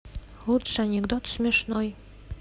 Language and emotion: Russian, neutral